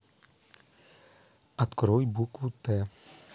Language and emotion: Russian, neutral